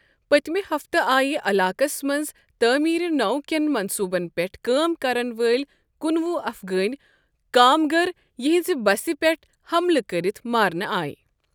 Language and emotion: Kashmiri, neutral